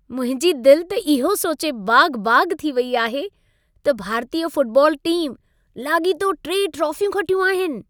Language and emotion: Sindhi, happy